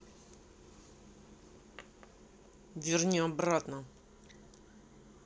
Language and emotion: Russian, angry